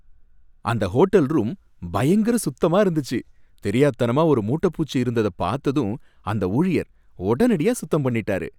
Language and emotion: Tamil, happy